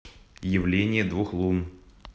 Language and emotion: Russian, neutral